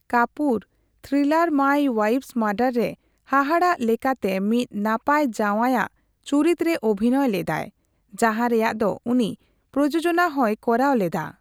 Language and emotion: Santali, neutral